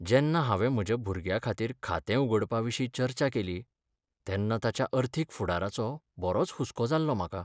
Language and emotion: Goan Konkani, sad